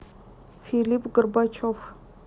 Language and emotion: Russian, neutral